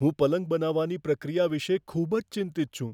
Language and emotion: Gujarati, fearful